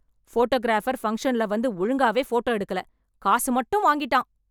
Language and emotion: Tamil, angry